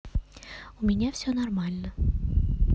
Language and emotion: Russian, neutral